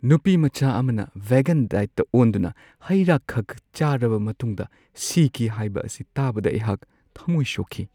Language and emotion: Manipuri, sad